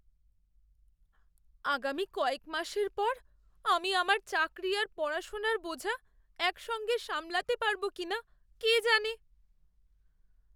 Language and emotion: Bengali, fearful